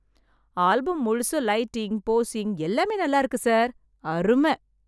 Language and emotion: Tamil, happy